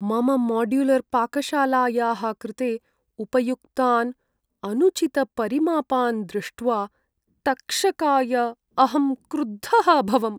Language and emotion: Sanskrit, sad